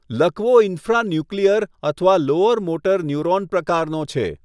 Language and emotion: Gujarati, neutral